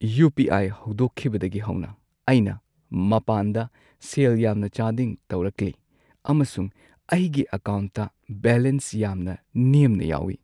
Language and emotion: Manipuri, sad